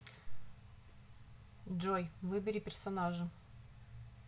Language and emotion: Russian, neutral